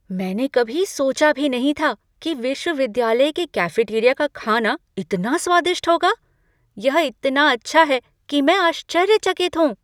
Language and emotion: Hindi, surprised